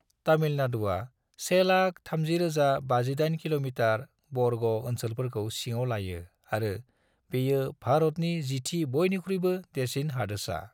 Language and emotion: Bodo, neutral